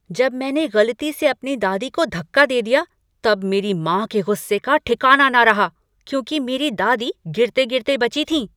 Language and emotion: Hindi, angry